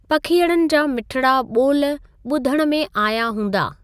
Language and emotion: Sindhi, neutral